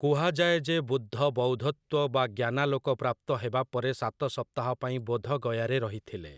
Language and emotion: Odia, neutral